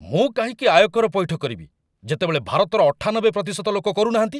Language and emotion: Odia, angry